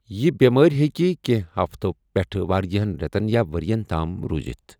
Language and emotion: Kashmiri, neutral